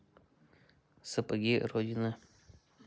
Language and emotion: Russian, neutral